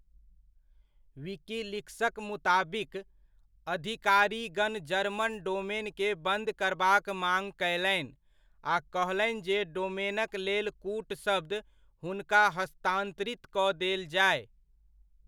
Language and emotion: Maithili, neutral